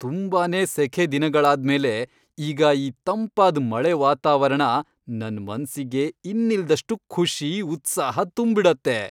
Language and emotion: Kannada, happy